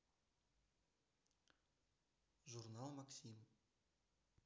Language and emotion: Russian, neutral